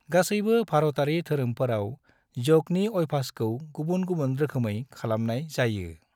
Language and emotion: Bodo, neutral